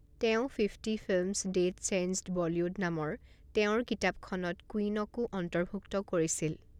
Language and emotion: Assamese, neutral